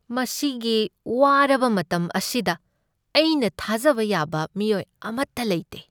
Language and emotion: Manipuri, sad